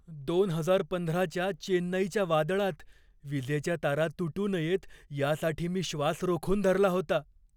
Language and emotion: Marathi, fearful